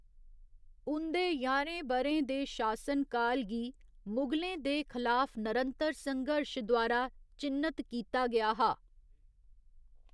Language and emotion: Dogri, neutral